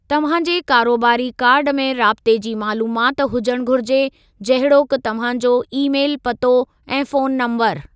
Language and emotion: Sindhi, neutral